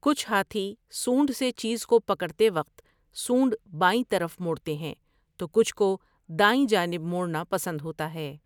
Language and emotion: Urdu, neutral